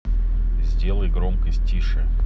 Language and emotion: Russian, neutral